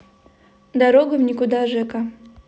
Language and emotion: Russian, neutral